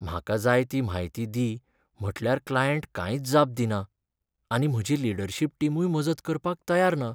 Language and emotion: Goan Konkani, sad